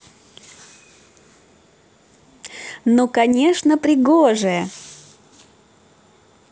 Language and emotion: Russian, positive